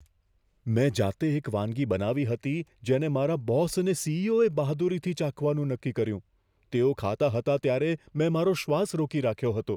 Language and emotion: Gujarati, fearful